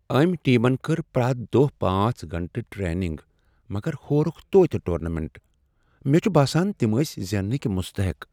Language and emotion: Kashmiri, sad